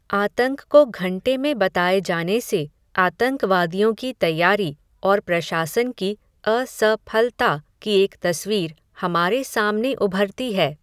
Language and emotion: Hindi, neutral